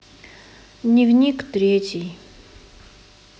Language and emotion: Russian, sad